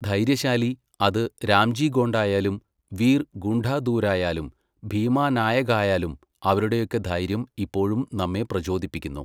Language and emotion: Malayalam, neutral